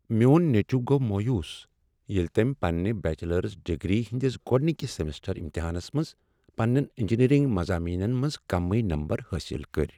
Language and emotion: Kashmiri, sad